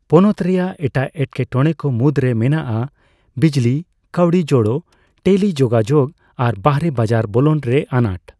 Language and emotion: Santali, neutral